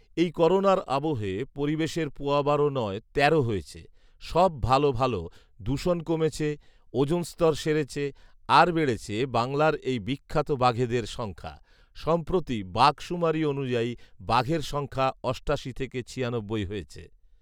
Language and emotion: Bengali, neutral